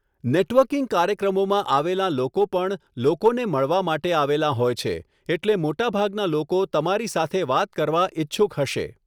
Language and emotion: Gujarati, neutral